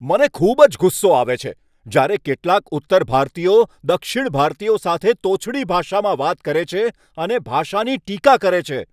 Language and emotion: Gujarati, angry